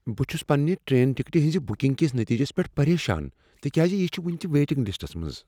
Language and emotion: Kashmiri, fearful